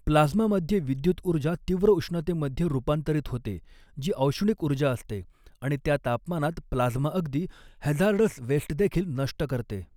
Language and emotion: Marathi, neutral